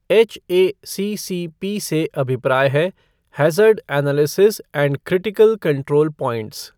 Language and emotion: Hindi, neutral